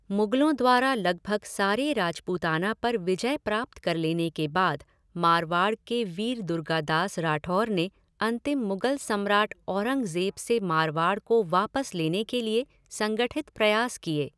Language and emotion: Hindi, neutral